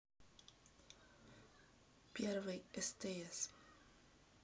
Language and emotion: Russian, neutral